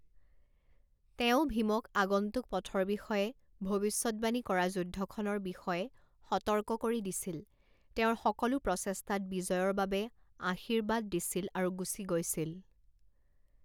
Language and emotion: Assamese, neutral